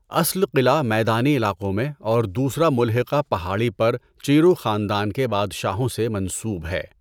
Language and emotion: Urdu, neutral